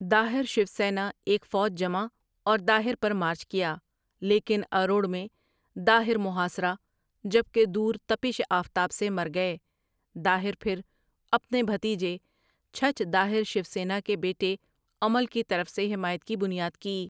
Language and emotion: Urdu, neutral